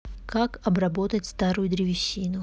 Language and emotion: Russian, neutral